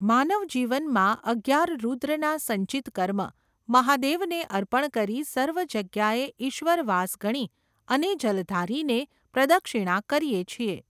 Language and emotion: Gujarati, neutral